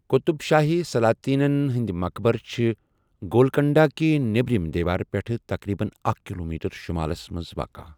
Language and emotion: Kashmiri, neutral